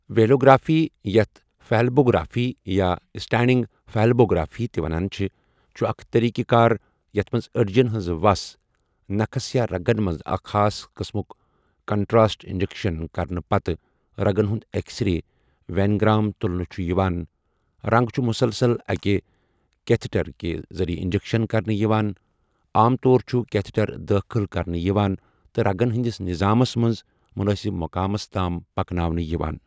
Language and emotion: Kashmiri, neutral